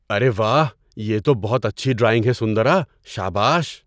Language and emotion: Urdu, surprised